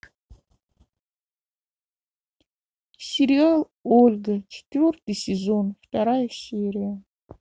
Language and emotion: Russian, sad